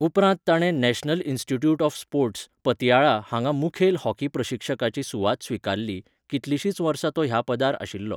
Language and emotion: Goan Konkani, neutral